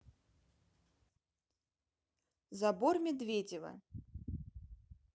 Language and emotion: Russian, neutral